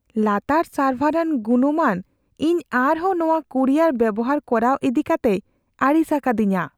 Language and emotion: Santali, fearful